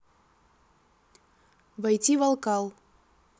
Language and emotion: Russian, neutral